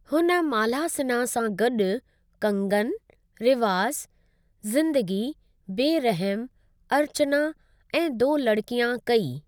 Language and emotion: Sindhi, neutral